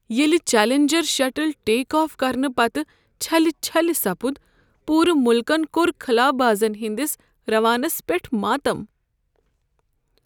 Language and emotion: Kashmiri, sad